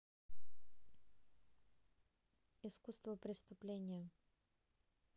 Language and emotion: Russian, neutral